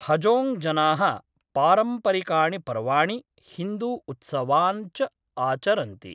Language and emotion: Sanskrit, neutral